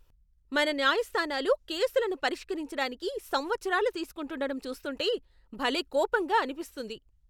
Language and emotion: Telugu, angry